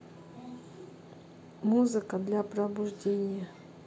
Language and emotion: Russian, neutral